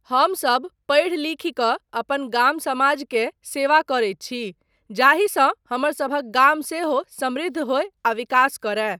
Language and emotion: Maithili, neutral